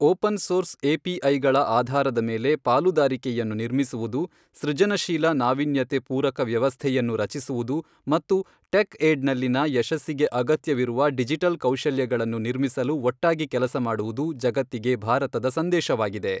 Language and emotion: Kannada, neutral